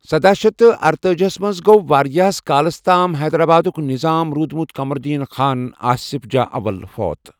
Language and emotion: Kashmiri, neutral